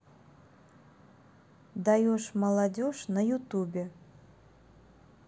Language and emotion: Russian, neutral